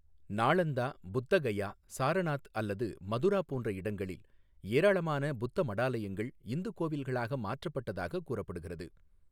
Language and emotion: Tamil, neutral